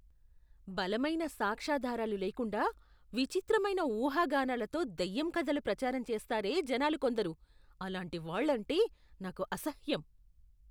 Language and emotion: Telugu, disgusted